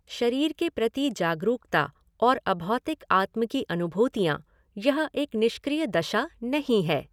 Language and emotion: Hindi, neutral